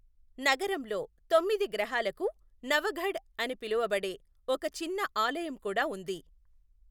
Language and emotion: Telugu, neutral